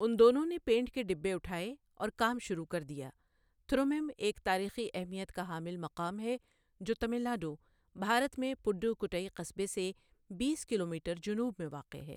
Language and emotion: Urdu, neutral